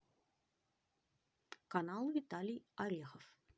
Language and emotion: Russian, positive